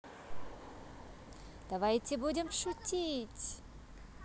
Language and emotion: Russian, positive